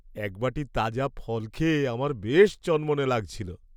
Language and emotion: Bengali, happy